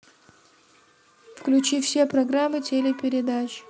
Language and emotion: Russian, neutral